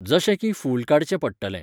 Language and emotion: Goan Konkani, neutral